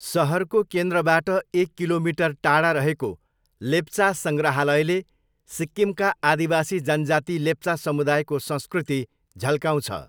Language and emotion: Nepali, neutral